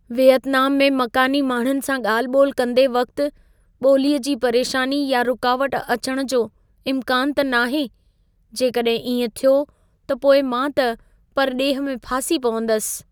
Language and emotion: Sindhi, fearful